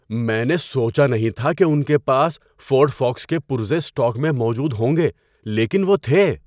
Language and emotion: Urdu, surprised